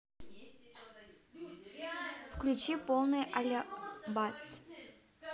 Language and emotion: Russian, neutral